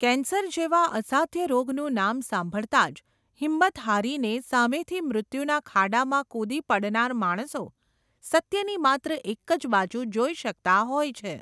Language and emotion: Gujarati, neutral